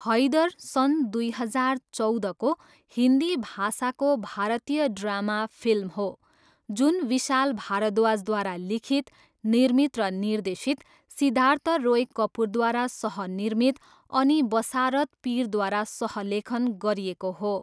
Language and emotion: Nepali, neutral